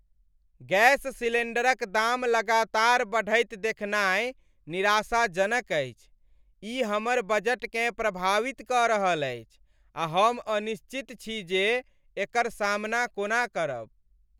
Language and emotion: Maithili, sad